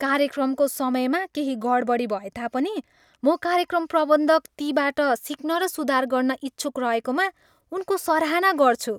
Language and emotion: Nepali, happy